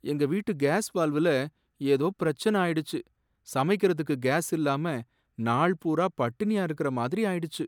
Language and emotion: Tamil, sad